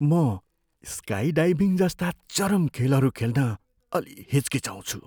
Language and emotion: Nepali, fearful